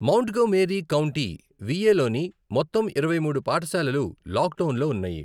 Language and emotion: Telugu, neutral